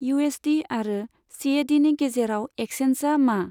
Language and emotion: Bodo, neutral